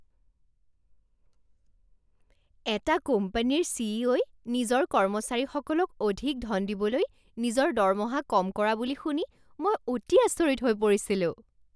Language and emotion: Assamese, surprised